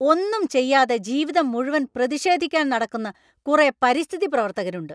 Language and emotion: Malayalam, angry